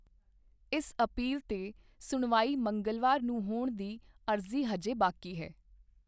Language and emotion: Punjabi, neutral